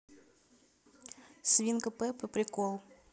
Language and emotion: Russian, neutral